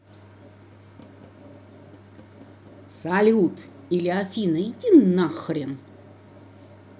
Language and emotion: Russian, angry